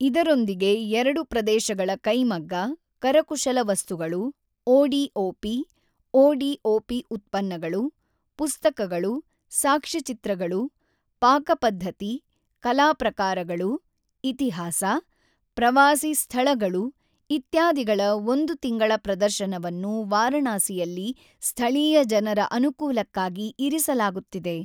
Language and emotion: Kannada, neutral